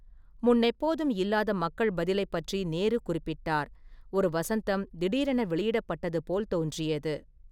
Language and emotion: Tamil, neutral